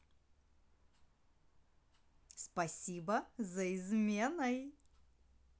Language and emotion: Russian, positive